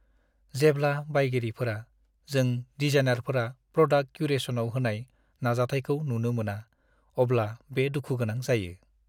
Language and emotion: Bodo, sad